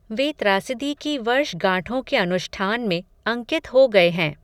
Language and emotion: Hindi, neutral